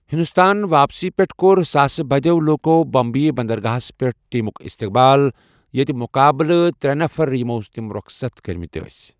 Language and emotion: Kashmiri, neutral